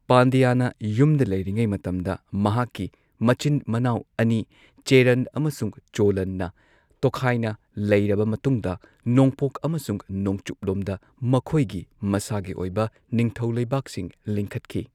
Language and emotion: Manipuri, neutral